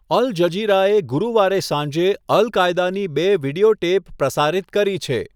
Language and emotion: Gujarati, neutral